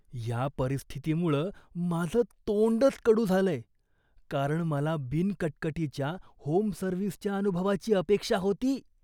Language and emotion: Marathi, disgusted